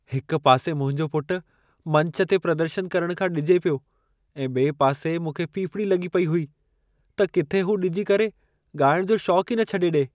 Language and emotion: Sindhi, fearful